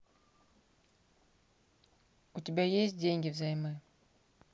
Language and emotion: Russian, neutral